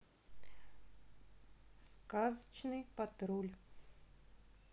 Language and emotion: Russian, neutral